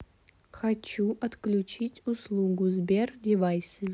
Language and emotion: Russian, neutral